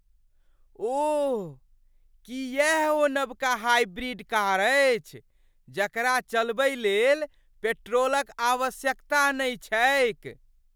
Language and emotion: Maithili, surprised